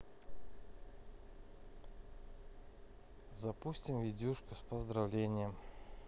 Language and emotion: Russian, neutral